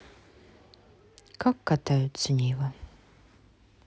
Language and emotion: Russian, neutral